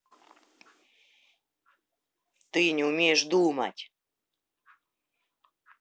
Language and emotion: Russian, angry